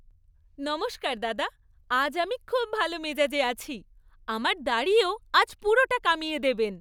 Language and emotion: Bengali, happy